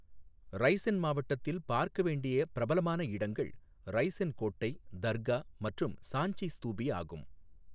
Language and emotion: Tamil, neutral